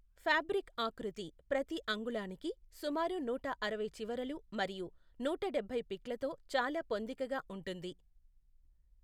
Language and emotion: Telugu, neutral